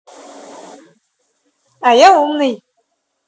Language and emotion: Russian, positive